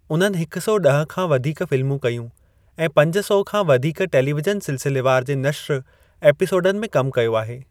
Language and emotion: Sindhi, neutral